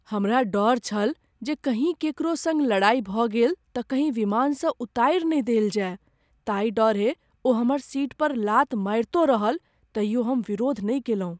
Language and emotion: Maithili, fearful